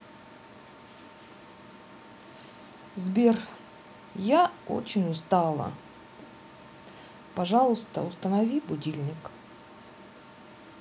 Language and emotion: Russian, sad